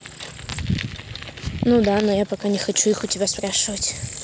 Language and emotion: Russian, neutral